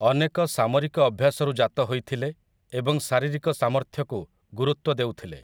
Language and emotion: Odia, neutral